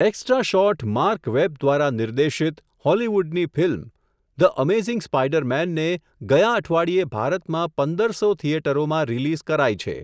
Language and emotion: Gujarati, neutral